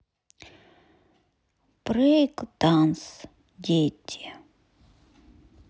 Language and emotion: Russian, sad